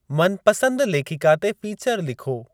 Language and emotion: Sindhi, neutral